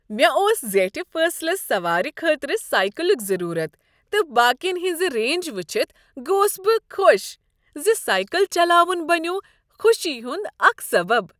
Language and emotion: Kashmiri, happy